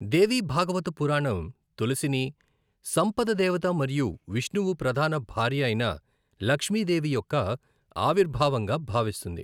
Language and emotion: Telugu, neutral